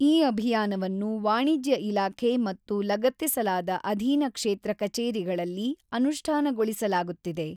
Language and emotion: Kannada, neutral